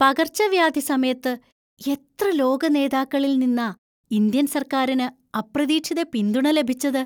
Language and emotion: Malayalam, surprised